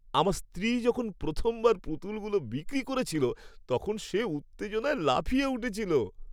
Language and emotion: Bengali, happy